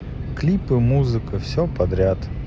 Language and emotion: Russian, sad